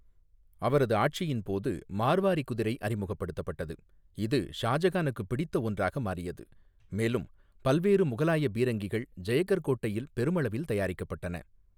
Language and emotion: Tamil, neutral